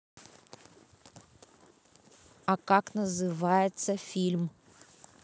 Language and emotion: Russian, neutral